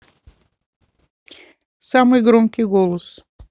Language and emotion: Russian, neutral